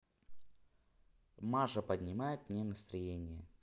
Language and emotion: Russian, neutral